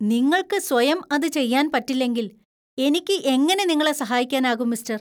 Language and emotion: Malayalam, disgusted